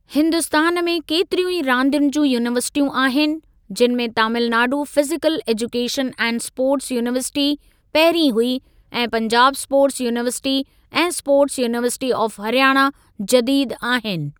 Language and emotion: Sindhi, neutral